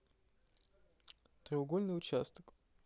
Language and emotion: Russian, neutral